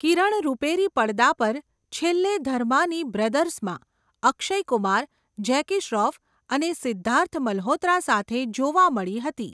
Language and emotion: Gujarati, neutral